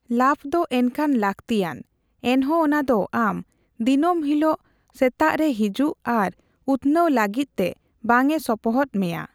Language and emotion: Santali, neutral